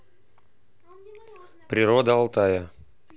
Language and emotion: Russian, neutral